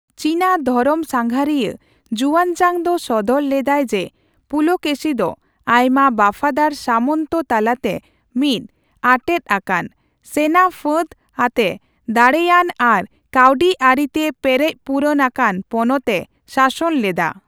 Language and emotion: Santali, neutral